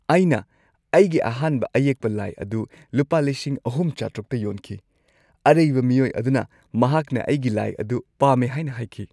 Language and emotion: Manipuri, happy